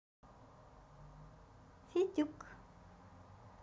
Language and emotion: Russian, positive